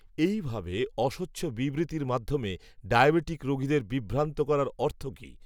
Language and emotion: Bengali, neutral